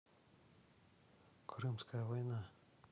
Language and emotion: Russian, neutral